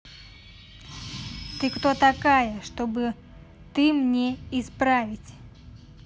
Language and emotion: Russian, angry